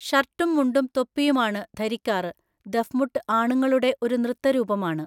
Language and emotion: Malayalam, neutral